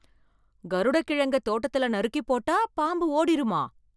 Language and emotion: Tamil, surprised